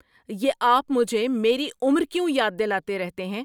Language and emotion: Urdu, angry